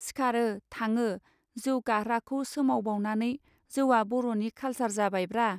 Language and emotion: Bodo, neutral